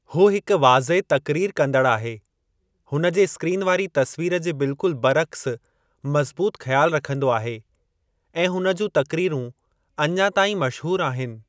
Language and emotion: Sindhi, neutral